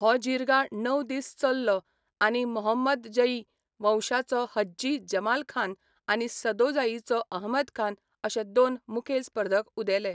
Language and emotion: Goan Konkani, neutral